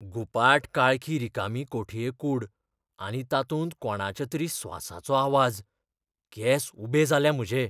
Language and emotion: Goan Konkani, fearful